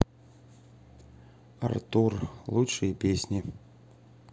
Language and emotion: Russian, neutral